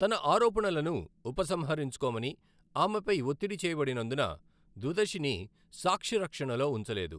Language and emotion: Telugu, neutral